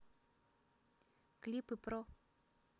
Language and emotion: Russian, neutral